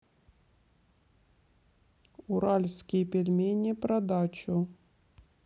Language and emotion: Russian, neutral